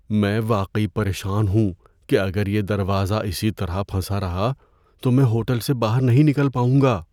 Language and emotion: Urdu, fearful